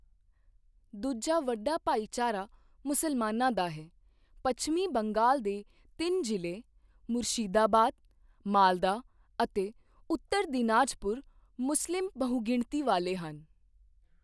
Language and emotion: Punjabi, neutral